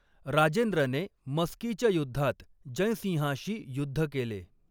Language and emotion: Marathi, neutral